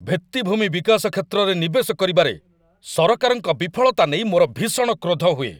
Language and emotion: Odia, angry